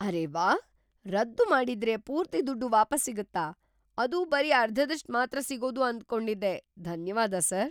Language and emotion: Kannada, surprised